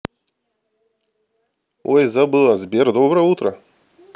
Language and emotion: Russian, positive